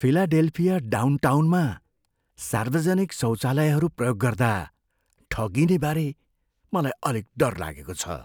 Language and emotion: Nepali, fearful